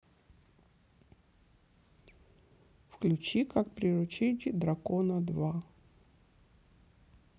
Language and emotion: Russian, neutral